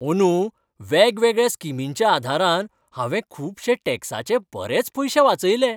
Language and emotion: Goan Konkani, happy